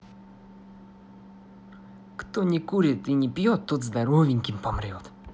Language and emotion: Russian, positive